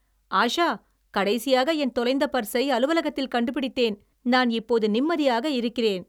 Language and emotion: Tamil, happy